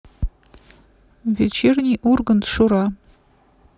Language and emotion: Russian, neutral